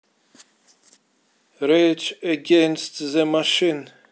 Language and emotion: Russian, neutral